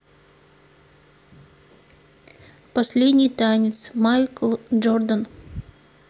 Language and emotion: Russian, neutral